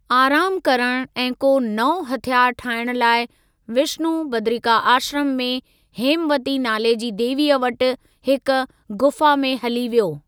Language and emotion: Sindhi, neutral